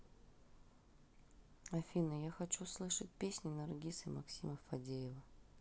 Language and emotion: Russian, sad